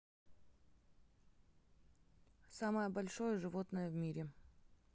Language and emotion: Russian, neutral